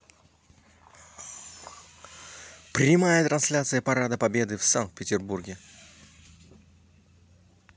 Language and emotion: Russian, positive